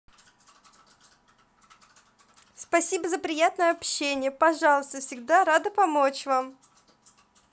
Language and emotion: Russian, positive